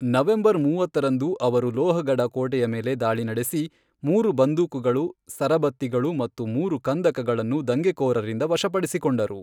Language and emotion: Kannada, neutral